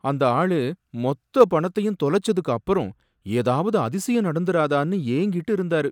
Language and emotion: Tamil, sad